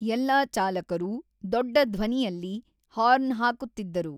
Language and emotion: Kannada, neutral